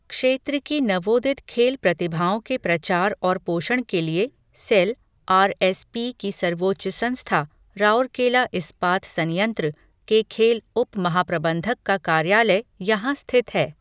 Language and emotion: Hindi, neutral